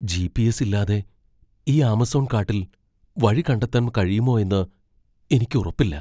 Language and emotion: Malayalam, fearful